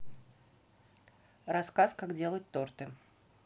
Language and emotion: Russian, neutral